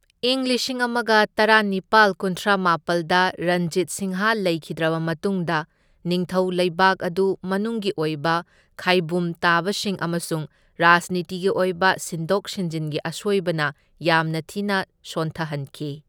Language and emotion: Manipuri, neutral